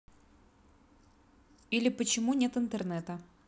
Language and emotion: Russian, neutral